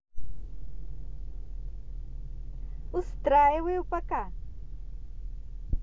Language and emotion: Russian, positive